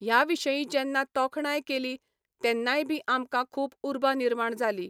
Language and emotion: Goan Konkani, neutral